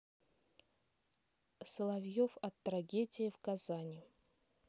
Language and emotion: Russian, neutral